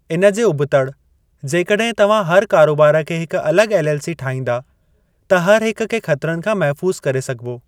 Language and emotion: Sindhi, neutral